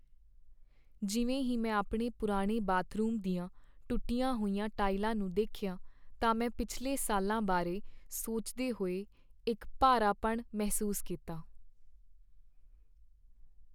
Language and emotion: Punjabi, sad